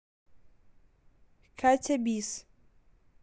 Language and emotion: Russian, neutral